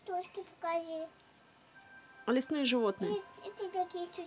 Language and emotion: Russian, neutral